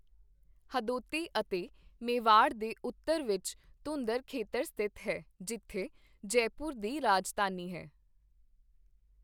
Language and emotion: Punjabi, neutral